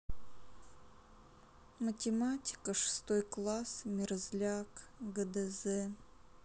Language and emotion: Russian, sad